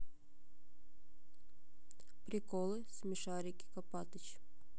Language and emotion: Russian, neutral